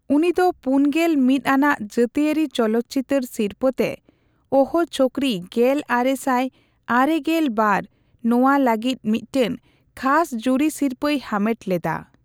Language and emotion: Santali, neutral